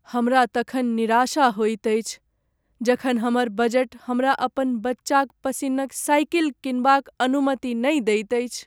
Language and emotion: Maithili, sad